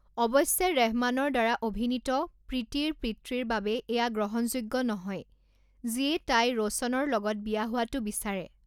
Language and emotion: Assamese, neutral